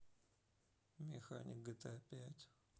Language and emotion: Russian, neutral